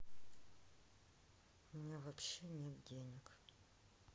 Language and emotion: Russian, sad